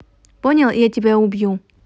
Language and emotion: Russian, neutral